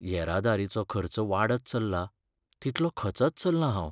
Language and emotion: Goan Konkani, sad